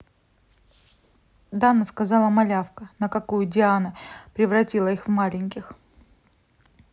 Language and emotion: Russian, neutral